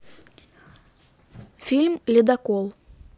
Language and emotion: Russian, neutral